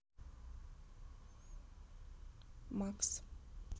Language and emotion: Russian, neutral